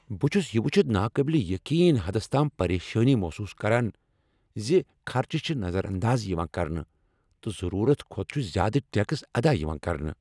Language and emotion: Kashmiri, angry